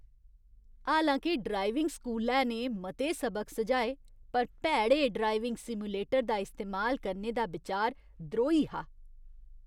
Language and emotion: Dogri, disgusted